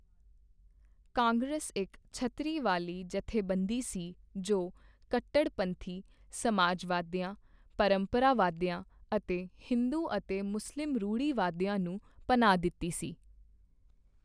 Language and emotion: Punjabi, neutral